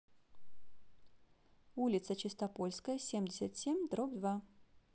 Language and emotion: Russian, neutral